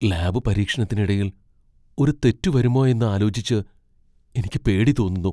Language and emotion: Malayalam, fearful